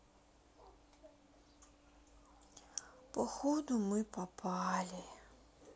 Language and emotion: Russian, sad